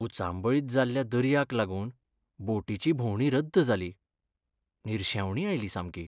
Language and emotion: Goan Konkani, sad